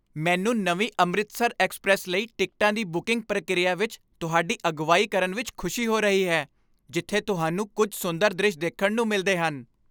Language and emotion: Punjabi, happy